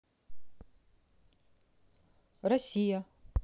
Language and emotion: Russian, neutral